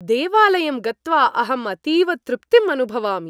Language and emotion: Sanskrit, happy